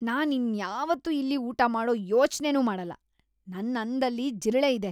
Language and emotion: Kannada, disgusted